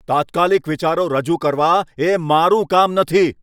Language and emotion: Gujarati, angry